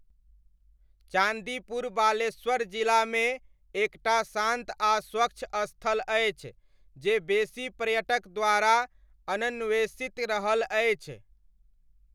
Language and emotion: Maithili, neutral